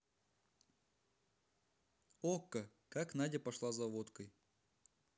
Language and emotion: Russian, neutral